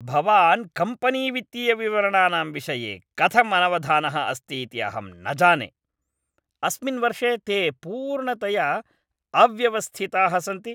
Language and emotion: Sanskrit, angry